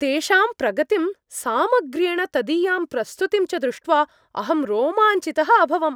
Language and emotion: Sanskrit, happy